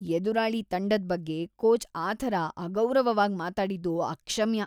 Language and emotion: Kannada, disgusted